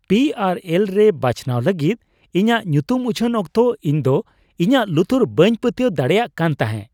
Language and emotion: Santali, surprised